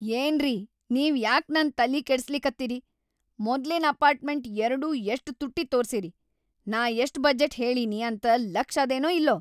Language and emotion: Kannada, angry